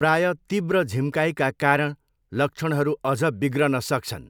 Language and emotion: Nepali, neutral